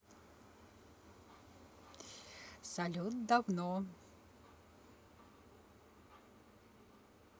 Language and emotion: Russian, positive